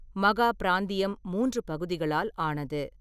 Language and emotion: Tamil, neutral